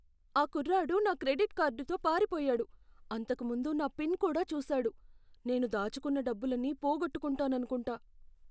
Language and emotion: Telugu, fearful